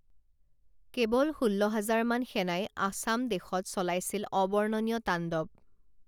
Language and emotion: Assamese, neutral